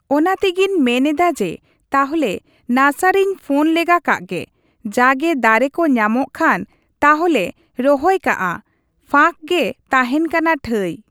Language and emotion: Santali, neutral